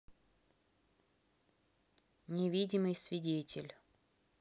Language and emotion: Russian, neutral